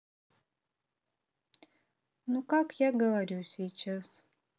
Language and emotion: Russian, neutral